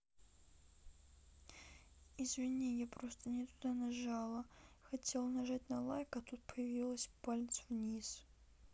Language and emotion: Russian, sad